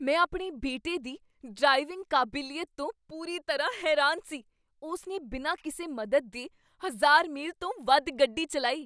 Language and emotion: Punjabi, surprised